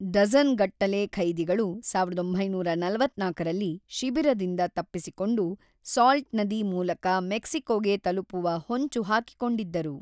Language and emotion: Kannada, neutral